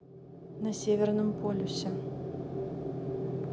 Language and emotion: Russian, neutral